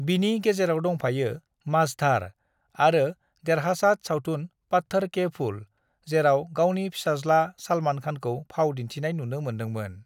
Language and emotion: Bodo, neutral